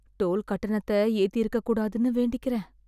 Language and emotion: Tamil, sad